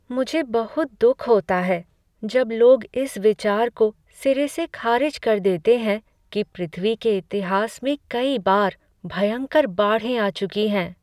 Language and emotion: Hindi, sad